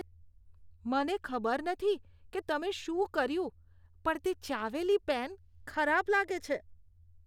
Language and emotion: Gujarati, disgusted